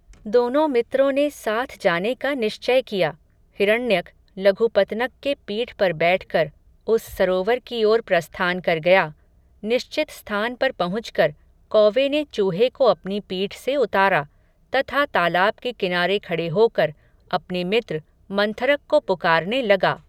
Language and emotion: Hindi, neutral